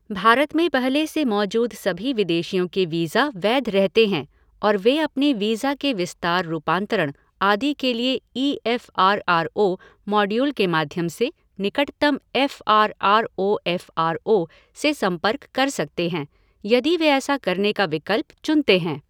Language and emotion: Hindi, neutral